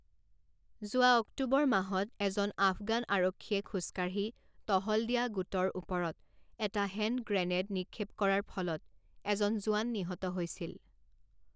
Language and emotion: Assamese, neutral